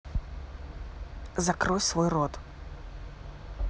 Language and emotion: Russian, angry